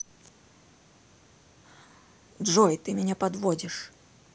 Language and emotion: Russian, angry